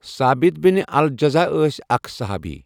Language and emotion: Kashmiri, neutral